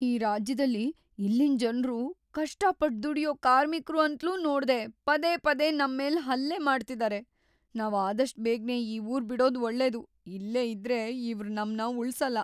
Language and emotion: Kannada, fearful